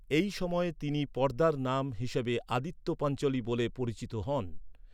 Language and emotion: Bengali, neutral